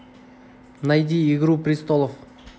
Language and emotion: Russian, neutral